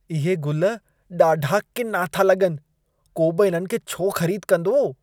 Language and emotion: Sindhi, disgusted